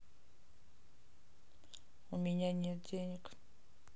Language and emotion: Russian, neutral